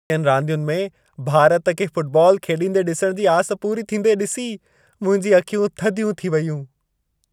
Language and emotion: Sindhi, happy